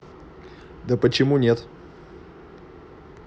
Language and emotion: Russian, neutral